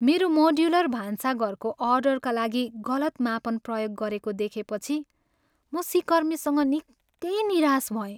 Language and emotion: Nepali, sad